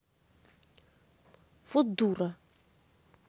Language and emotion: Russian, angry